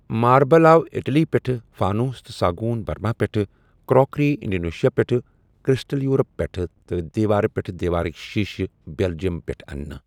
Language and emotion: Kashmiri, neutral